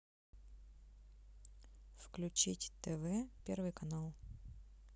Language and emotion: Russian, neutral